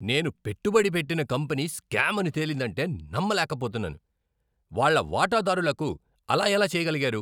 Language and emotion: Telugu, angry